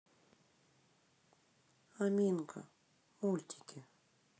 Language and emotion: Russian, neutral